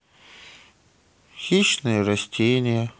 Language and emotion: Russian, sad